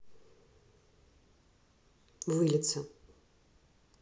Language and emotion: Russian, neutral